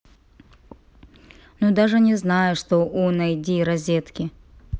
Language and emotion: Russian, neutral